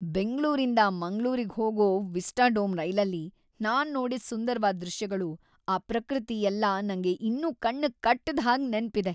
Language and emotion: Kannada, happy